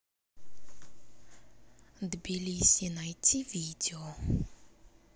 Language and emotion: Russian, neutral